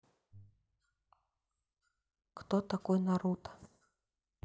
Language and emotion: Russian, neutral